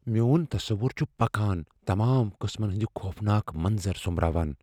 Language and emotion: Kashmiri, fearful